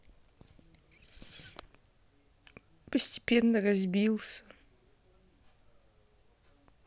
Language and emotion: Russian, sad